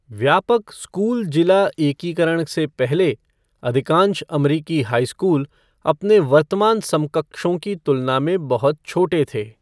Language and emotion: Hindi, neutral